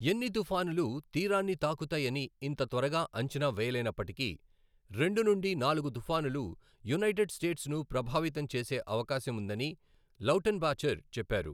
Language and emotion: Telugu, neutral